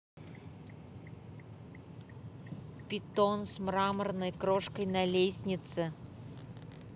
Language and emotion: Russian, neutral